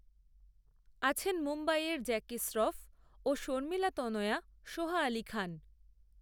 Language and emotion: Bengali, neutral